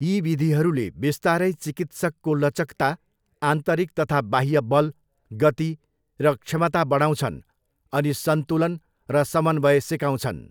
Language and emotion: Nepali, neutral